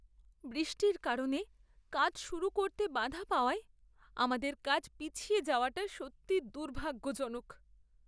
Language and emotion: Bengali, sad